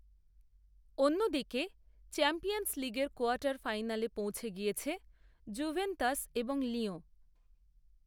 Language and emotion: Bengali, neutral